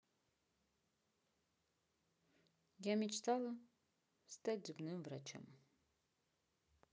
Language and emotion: Russian, sad